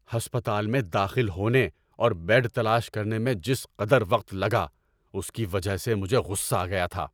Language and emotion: Urdu, angry